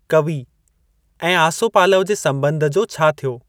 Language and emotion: Sindhi, neutral